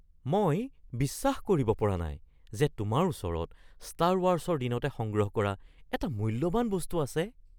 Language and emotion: Assamese, surprised